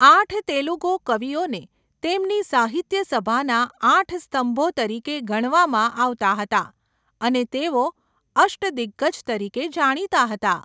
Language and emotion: Gujarati, neutral